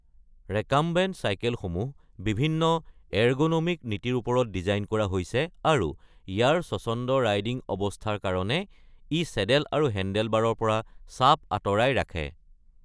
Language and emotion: Assamese, neutral